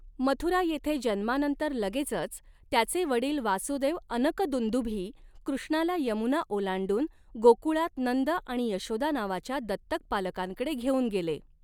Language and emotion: Marathi, neutral